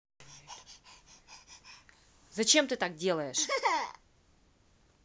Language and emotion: Russian, angry